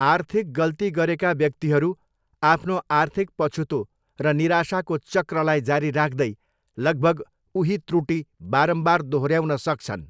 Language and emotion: Nepali, neutral